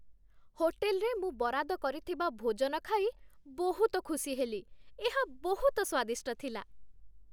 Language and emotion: Odia, happy